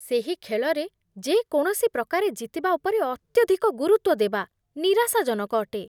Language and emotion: Odia, disgusted